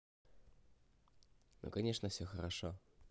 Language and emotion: Russian, positive